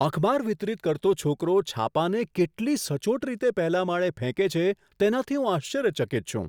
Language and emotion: Gujarati, surprised